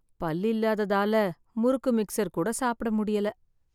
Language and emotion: Tamil, sad